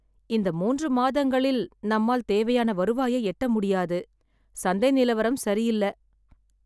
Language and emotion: Tamil, sad